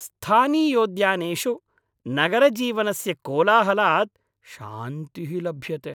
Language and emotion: Sanskrit, happy